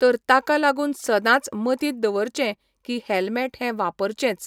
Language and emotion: Goan Konkani, neutral